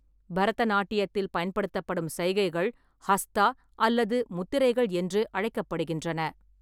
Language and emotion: Tamil, neutral